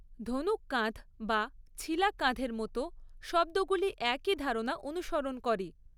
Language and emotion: Bengali, neutral